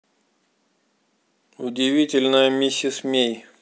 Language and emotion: Russian, neutral